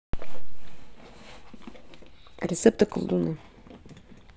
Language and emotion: Russian, neutral